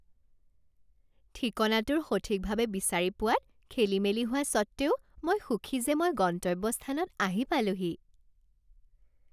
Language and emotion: Assamese, happy